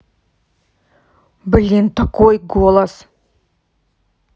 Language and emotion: Russian, angry